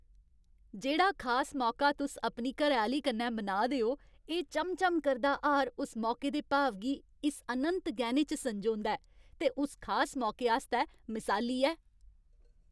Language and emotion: Dogri, happy